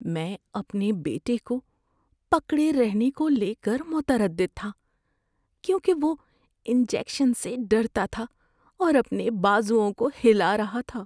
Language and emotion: Urdu, fearful